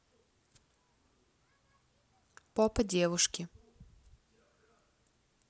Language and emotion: Russian, neutral